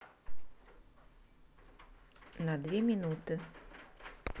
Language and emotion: Russian, neutral